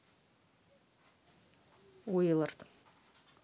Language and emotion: Russian, neutral